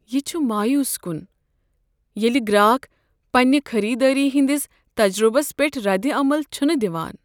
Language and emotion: Kashmiri, sad